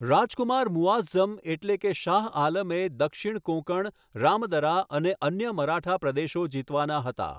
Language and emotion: Gujarati, neutral